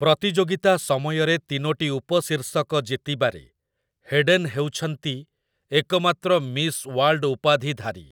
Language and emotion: Odia, neutral